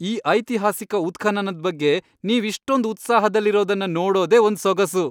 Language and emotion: Kannada, happy